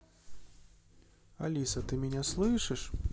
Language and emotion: Russian, neutral